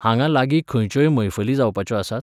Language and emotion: Goan Konkani, neutral